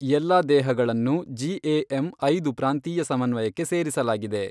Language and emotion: Kannada, neutral